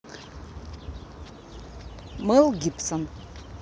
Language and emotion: Russian, neutral